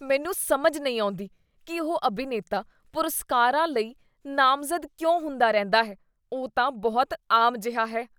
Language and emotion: Punjabi, disgusted